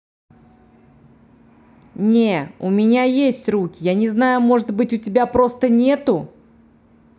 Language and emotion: Russian, angry